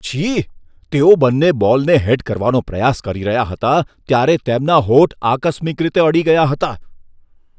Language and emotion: Gujarati, disgusted